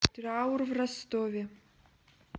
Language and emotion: Russian, neutral